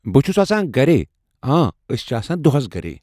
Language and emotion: Kashmiri, neutral